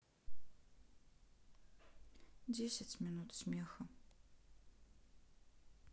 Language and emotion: Russian, sad